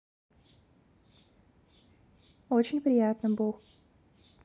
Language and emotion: Russian, neutral